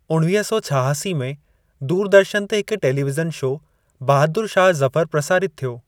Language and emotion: Sindhi, neutral